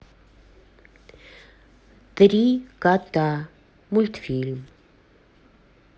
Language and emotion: Russian, neutral